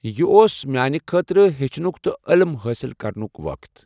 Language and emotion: Kashmiri, neutral